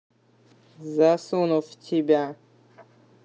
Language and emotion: Russian, angry